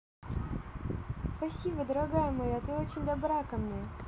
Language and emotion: Russian, positive